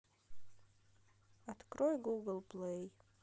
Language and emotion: Russian, neutral